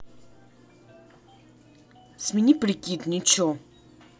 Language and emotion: Russian, angry